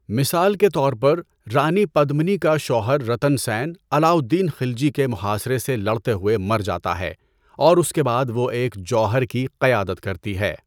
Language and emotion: Urdu, neutral